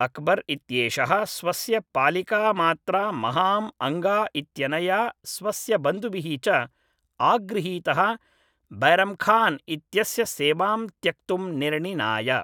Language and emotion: Sanskrit, neutral